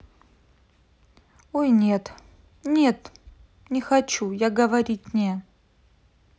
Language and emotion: Russian, sad